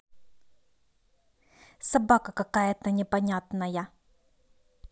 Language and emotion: Russian, angry